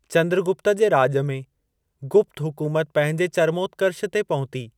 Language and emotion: Sindhi, neutral